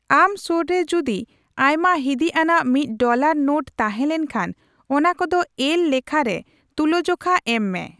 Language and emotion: Santali, neutral